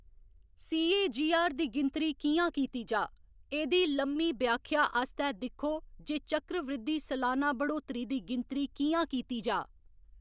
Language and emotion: Dogri, neutral